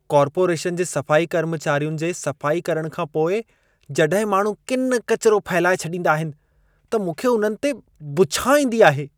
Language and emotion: Sindhi, disgusted